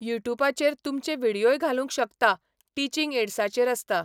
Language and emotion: Goan Konkani, neutral